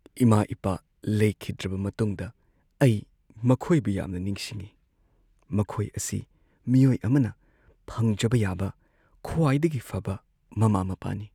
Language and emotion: Manipuri, sad